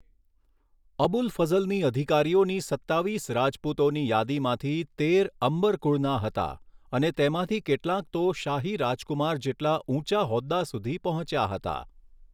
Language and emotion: Gujarati, neutral